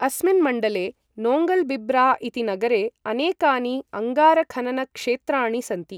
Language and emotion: Sanskrit, neutral